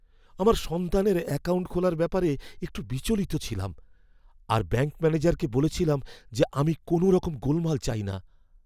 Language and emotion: Bengali, fearful